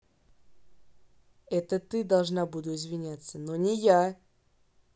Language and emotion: Russian, angry